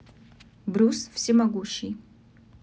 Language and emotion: Russian, neutral